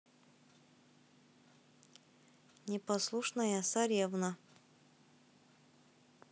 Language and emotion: Russian, neutral